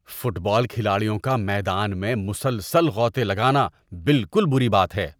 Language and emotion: Urdu, disgusted